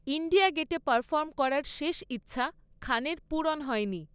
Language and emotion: Bengali, neutral